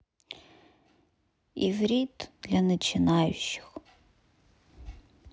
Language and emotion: Russian, sad